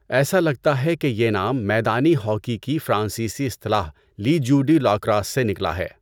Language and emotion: Urdu, neutral